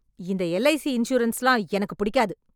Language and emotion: Tamil, angry